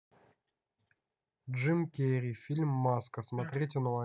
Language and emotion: Russian, neutral